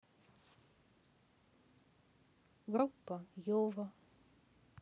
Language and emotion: Russian, neutral